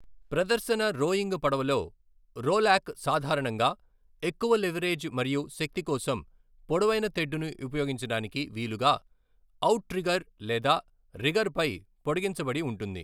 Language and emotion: Telugu, neutral